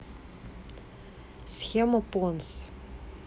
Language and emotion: Russian, neutral